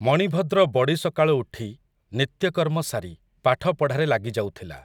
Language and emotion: Odia, neutral